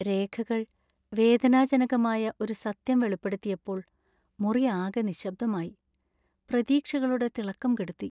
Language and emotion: Malayalam, sad